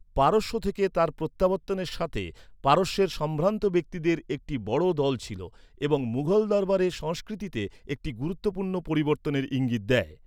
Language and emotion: Bengali, neutral